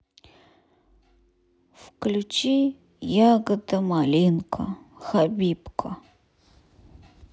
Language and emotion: Russian, sad